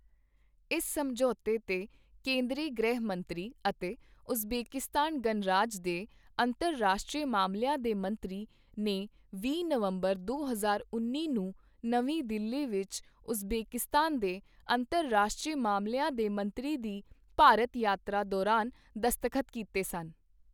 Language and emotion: Punjabi, neutral